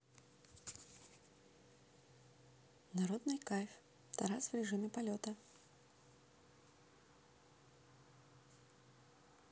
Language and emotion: Russian, neutral